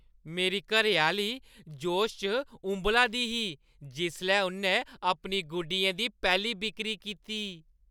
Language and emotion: Dogri, happy